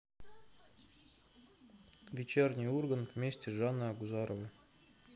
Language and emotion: Russian, neutral